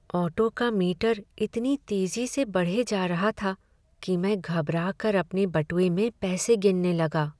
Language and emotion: Hindi, sad